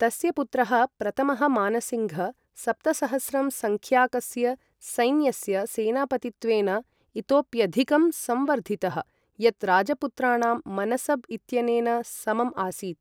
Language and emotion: Sanskrit, neutral